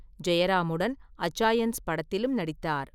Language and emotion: Tamil, neutral